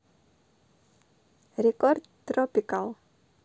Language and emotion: Russian, neutral